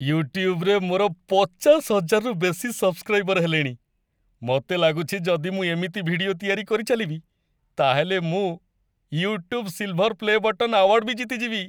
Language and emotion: Odia, happy